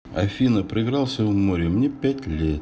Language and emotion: Russian, neutral